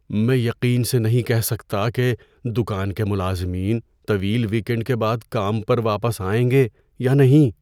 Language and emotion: Urdu, fearful